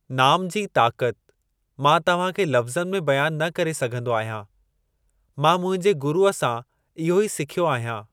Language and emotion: Sindhi, neutral